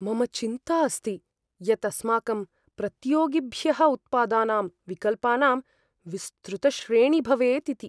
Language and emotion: Sanskrit, fearful